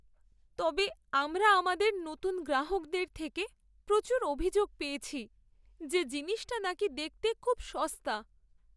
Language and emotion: Bengali, sad